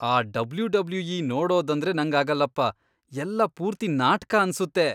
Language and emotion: Kannada, disgusted